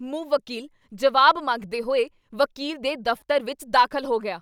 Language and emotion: Punjabi, angry